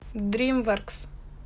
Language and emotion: Russian, neutral